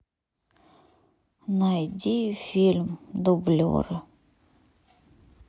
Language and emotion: Russian, sad